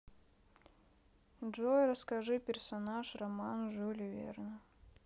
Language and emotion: Russian, sad